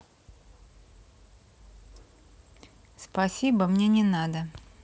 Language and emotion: Russian, neutral